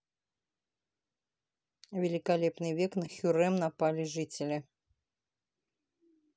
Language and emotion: Russian, neutral